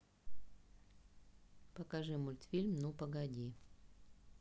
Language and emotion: Russian, neutral